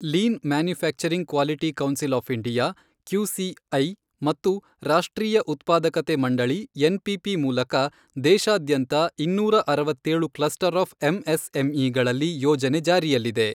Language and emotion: Kannada, neutral